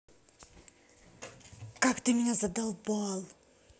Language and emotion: Russian, angry